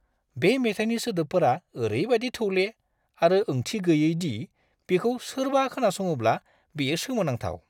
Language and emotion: Bodo, disgusted